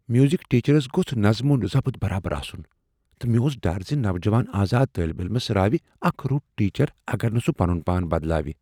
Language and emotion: Kashmiri, fearful